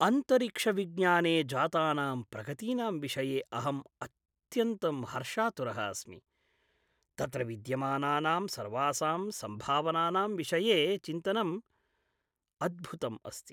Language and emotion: Sanskrit, happy